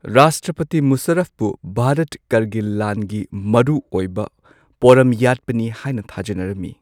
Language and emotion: Manipuri, neutral